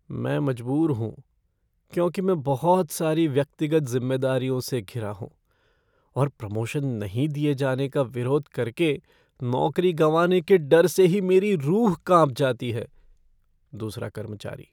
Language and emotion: Hindi, fearful